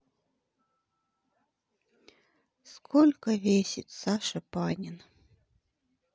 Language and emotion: Russian, sad